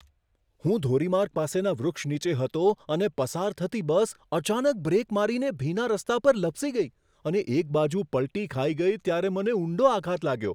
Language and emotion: Gujarati, surprised